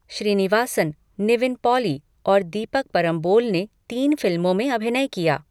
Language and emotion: Hindi, neutral